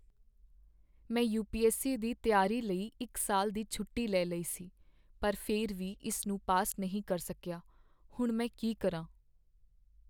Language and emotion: Punjabi, sad